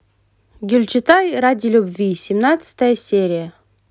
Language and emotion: Russian, positive